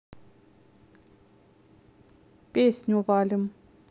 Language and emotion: Russian, neutral